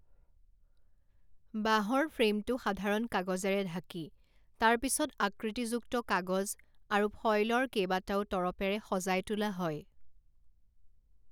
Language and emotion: Assamese, neutral